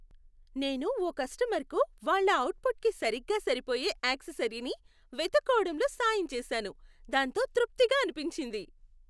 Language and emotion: Telugu, happy